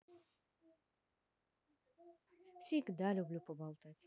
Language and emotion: Russian, positive